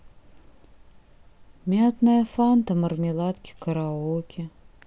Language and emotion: Russian, sad